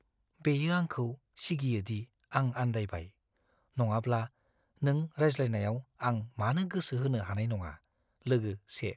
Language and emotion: Bodo, fearful